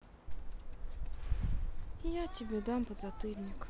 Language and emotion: Russian, sad